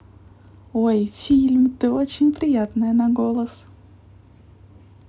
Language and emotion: Russian, positive